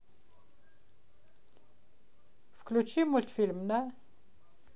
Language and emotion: Russian, neutral